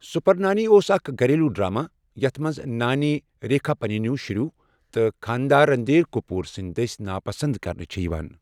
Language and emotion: Kashmiri, neutral